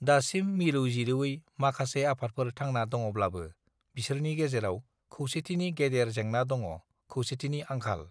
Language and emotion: Bodo, neutral